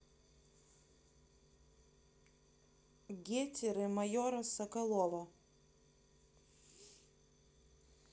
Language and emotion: Russian, neutral